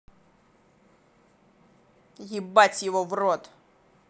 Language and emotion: Russian, angry